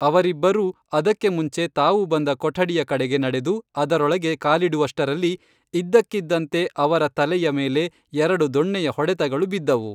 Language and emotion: Kannada, neutral